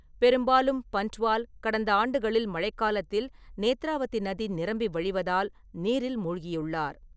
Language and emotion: Tamil, neutral